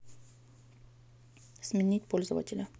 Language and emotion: Russian, neutral